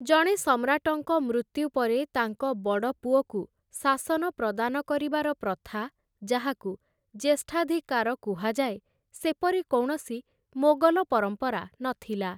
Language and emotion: Odia, neutral